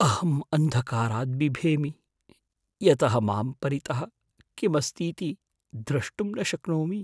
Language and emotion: Sanskrit, fearful